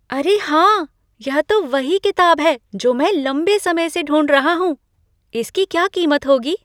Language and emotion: Hindi, surprised